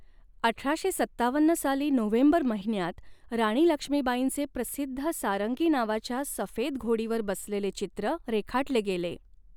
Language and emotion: Marathi, neutral